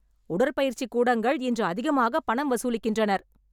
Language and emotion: Tamil, angry